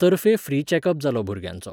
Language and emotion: Goan Konkani, neutral